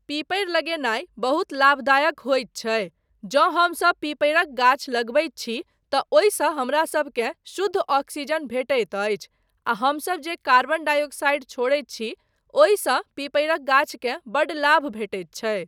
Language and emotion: Maithili, neutral